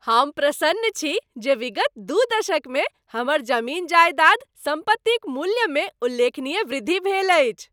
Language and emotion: Maithili, happy